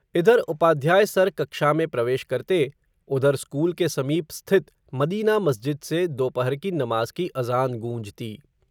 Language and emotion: Hindi, neutral